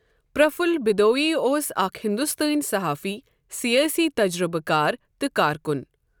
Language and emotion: Kashmiri, neutral